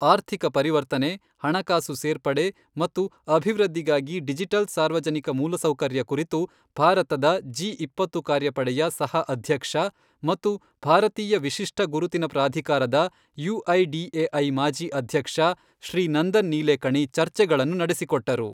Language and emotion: Kannada, neutral